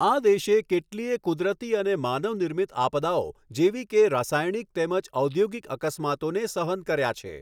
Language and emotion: Gujarati, neutral